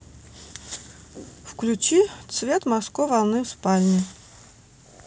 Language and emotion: Russian, neutral